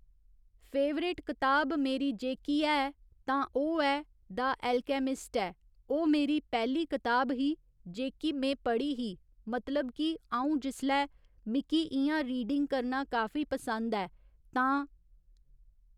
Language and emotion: Dogri, neutral